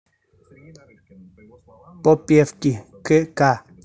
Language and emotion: Russian, neutral